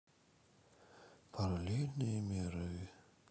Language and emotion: Russian, sad